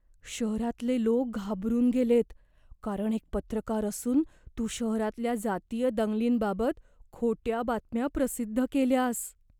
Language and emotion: Marathi, fearful